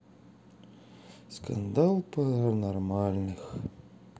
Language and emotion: Russian, sad